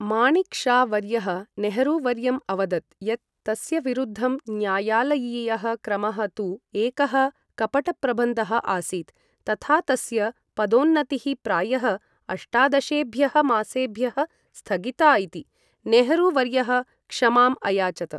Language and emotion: Sanskrit, neutral